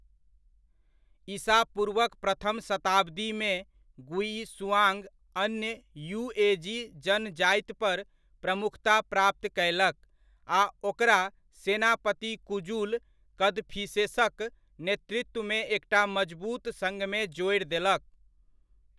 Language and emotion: Maithili, neutral